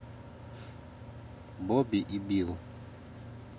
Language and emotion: Russian, neutral